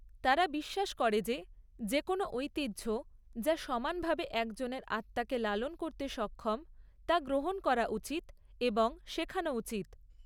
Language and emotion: Bengali, neutral